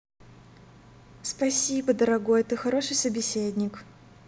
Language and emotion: Russian, positive